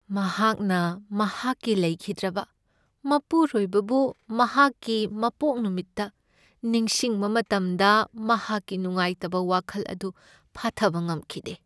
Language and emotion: Manipuri, sad